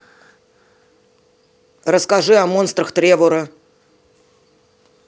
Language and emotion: Russian, neutral